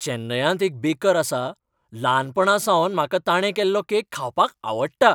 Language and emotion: Goan Konkani, happy